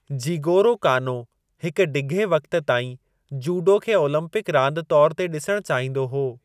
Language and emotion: Sindhi, neutral